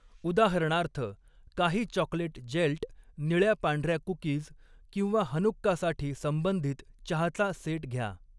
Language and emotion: Marathi, neutral